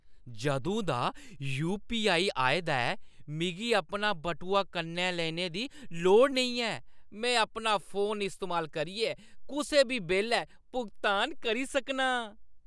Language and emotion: Dogri, happy